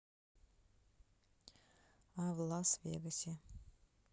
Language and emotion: Russian, neutral